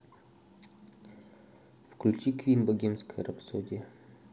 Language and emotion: Russian, neutral